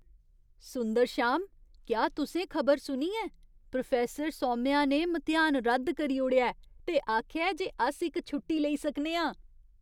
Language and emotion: Dogri, surprised